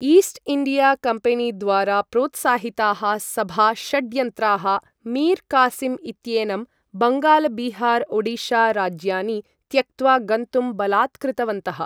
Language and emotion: Sanskrit, neutral